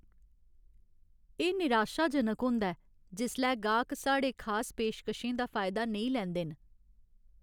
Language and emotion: Dogri, sad